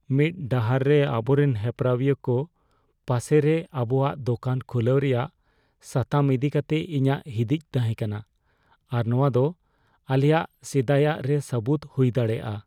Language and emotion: Santali, fearful